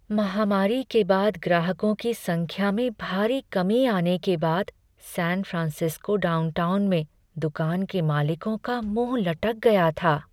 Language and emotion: Hindi, sad